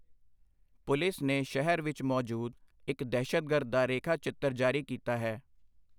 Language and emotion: Punjabi, neutral